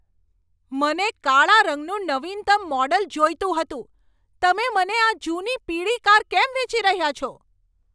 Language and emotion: Gujarati, angry